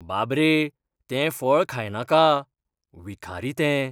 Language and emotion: Goan Konkani, fearful